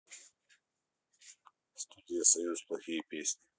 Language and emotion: Russian, neutral